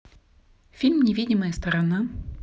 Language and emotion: Russian, neutral